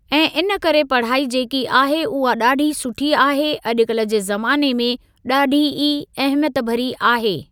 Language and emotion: Sindhi, neutral